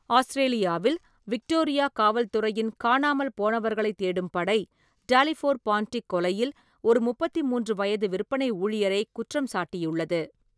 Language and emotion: Tamil, neutral